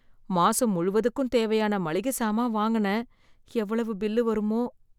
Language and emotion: Tamil, fearful